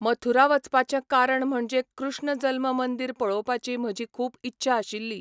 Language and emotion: Goan Konkani, neutral